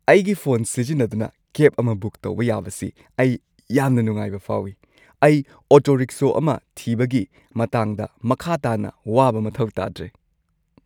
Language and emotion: Manipuri, happy